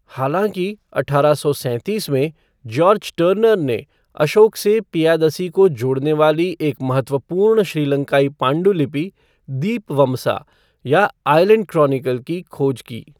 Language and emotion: Hindi, neutral